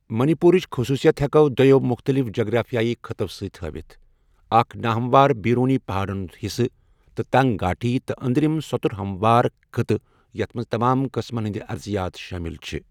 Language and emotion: Kashmiri, neutral